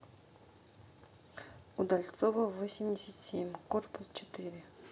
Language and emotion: Russian, neutral